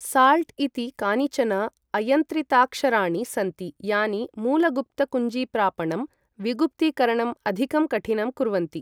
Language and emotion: Sanskrit, neutral